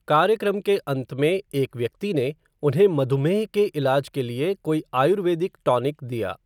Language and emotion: Hindi, neutral